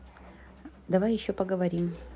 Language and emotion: Russian, neutral